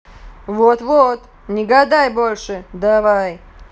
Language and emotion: Russian, angry